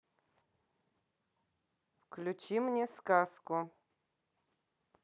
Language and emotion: Russian, neutral